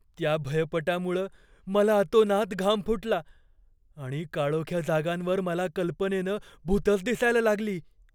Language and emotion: Marathi, fearful